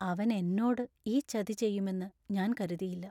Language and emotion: Malayalam, sad